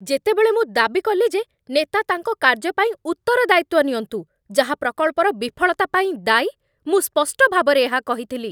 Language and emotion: Odia, angry